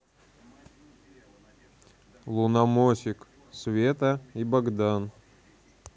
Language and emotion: Russian, neutral